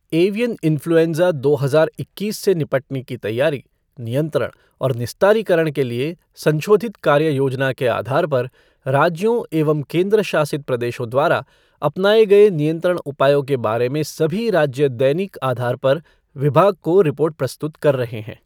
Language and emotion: Hindi, neutral